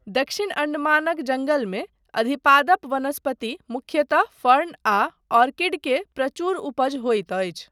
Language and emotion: Maithili, neutral